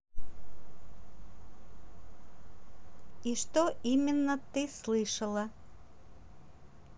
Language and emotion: Russian, neutral